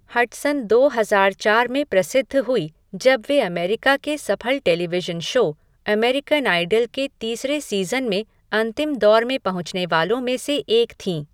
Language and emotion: Hindi, neutral